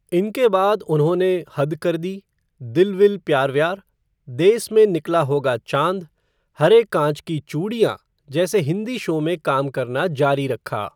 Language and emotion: Hindi, neutral